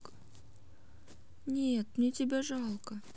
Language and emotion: Russian, sad